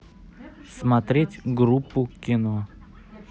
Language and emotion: Russian, neutral